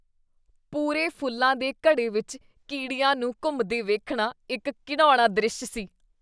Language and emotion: Punjabi, disgusted